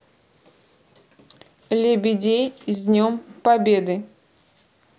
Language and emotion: Russian, neutral